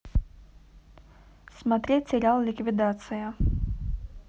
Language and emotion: Russian, neutral